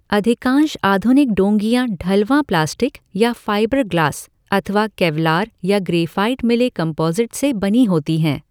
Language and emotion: Hindi, neutral